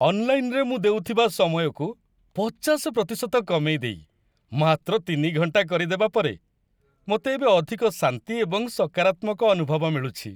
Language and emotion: Odia, happy